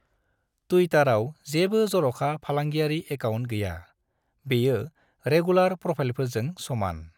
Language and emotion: Bodo, neutral